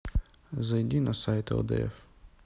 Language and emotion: Russian, neutral